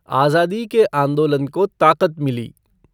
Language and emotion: Hindi, neutral